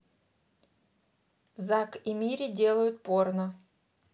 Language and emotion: Russian, neutral